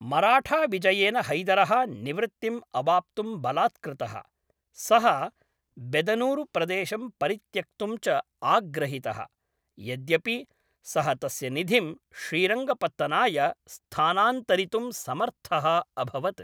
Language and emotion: Sanskrit, neutral